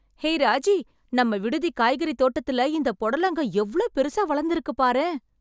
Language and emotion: Tamil, surprised